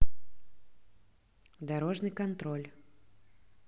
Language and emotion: Russian, neutral